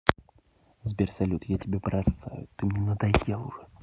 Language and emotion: Russian, angry